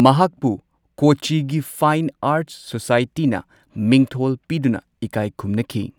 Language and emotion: Manipuri, neutral